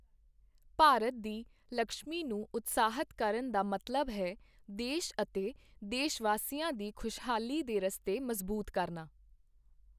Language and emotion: Punjabi, neutral